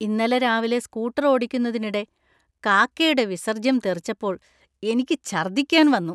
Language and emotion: Malayalam, disgusted